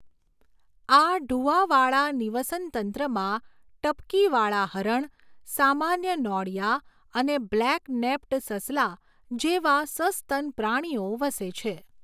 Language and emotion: Gujarati, neutral